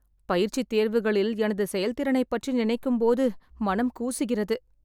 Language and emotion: Tamil, sad